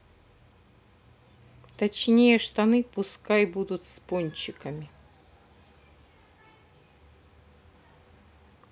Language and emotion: Russian, neutral